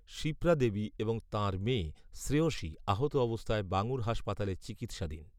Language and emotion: Bengali, neutral